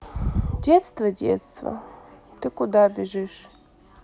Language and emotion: Russian, sad